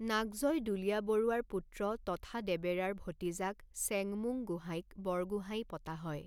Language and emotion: Assamese, neutral